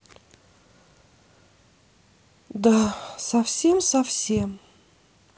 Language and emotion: Russian, sad